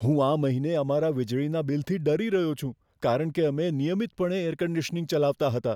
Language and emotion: Gujarati, fearful